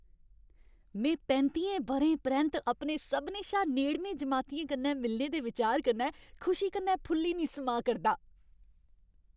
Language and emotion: Dogri, happy